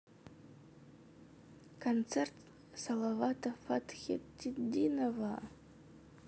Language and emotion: Russian, sad